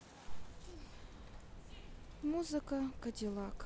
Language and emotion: Russian, neutral